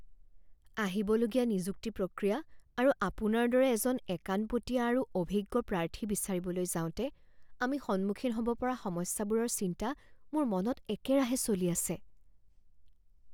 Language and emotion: Assamese, fearful